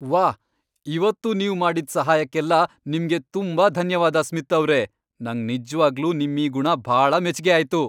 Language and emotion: Kannada, happy